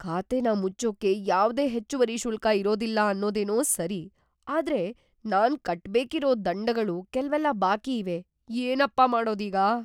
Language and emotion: Kannada, fearful